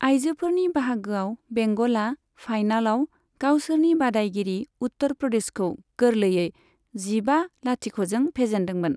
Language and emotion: Bodo, neutral